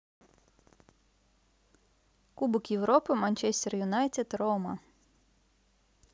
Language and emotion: Russian, neutral